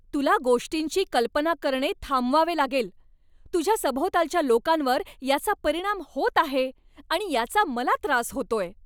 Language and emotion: Marathi, angry